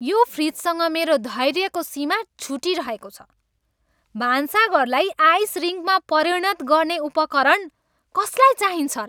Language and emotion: Nepali, angry